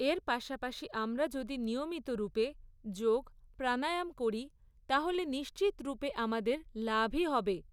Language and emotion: Bengali, neutral